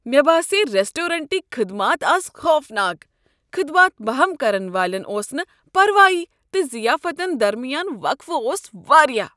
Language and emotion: Kashmiri, disgusted